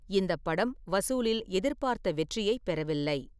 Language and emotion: Tamil, neutral